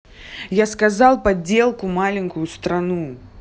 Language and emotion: Russian, angry